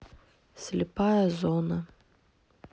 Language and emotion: Russian, neutral